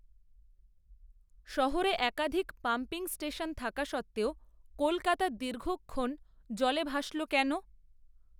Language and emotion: Bengali, neutral